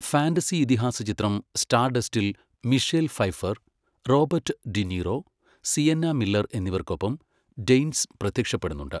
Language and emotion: Malayalam, neutral